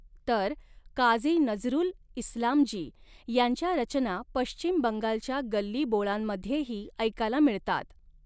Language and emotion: Marathi, neutral